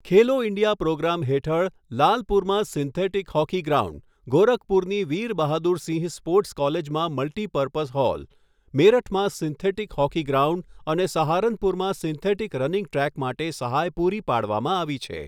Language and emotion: Gujarati, neutral